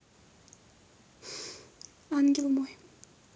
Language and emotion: Russian, sad